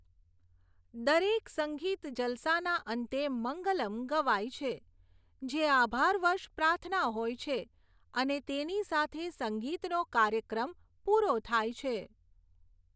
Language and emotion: Gujarati, neutral